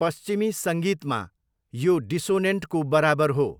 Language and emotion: Nepali, neutral